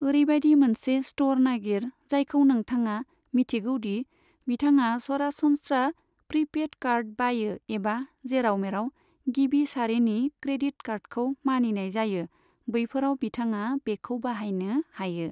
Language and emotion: Bodo, neutral